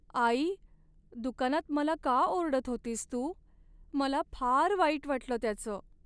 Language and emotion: Marathi, sad